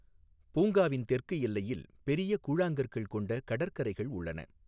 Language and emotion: Tamil, neutral